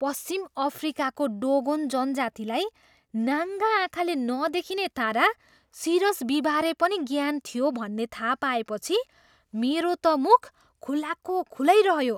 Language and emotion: Nepali, surprised